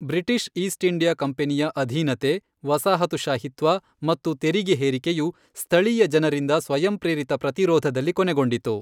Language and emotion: Kannada, neutral